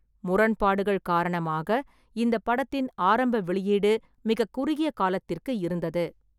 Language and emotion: Tamil, neutral